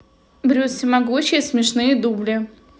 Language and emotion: Russian, neutral